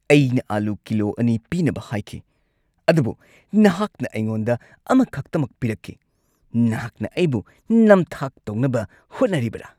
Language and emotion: Manipuri, angry